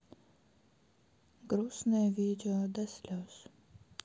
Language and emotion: Russian, sad